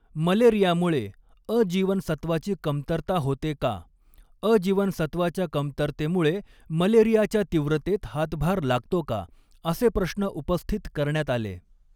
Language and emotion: Marathi, neutral